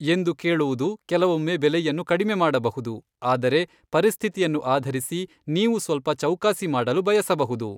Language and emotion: Kannada, neutral